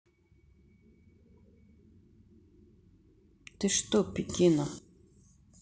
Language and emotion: Russian, neutral